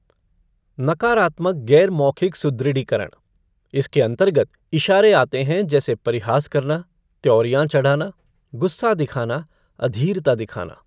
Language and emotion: Hindi, neutral